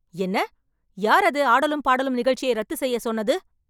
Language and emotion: Tamil, angry